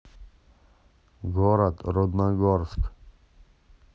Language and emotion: Russian, neutral